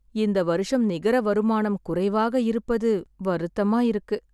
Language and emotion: Tamil, sad